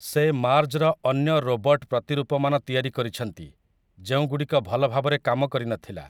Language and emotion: Odia, neutral